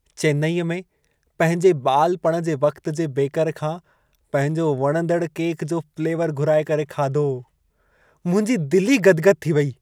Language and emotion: Sindhi, happy